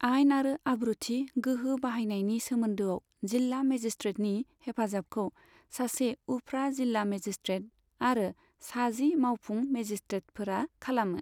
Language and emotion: Bodo, neutral